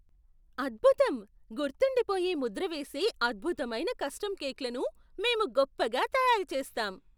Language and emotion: Telugu, surprised